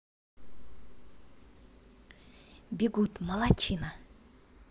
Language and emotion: Russian, positive